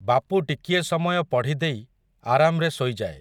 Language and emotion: Odia, neutral